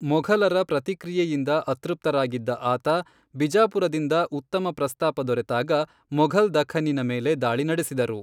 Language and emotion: Kannada, neutral